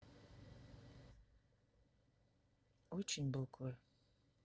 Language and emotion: Russian, sad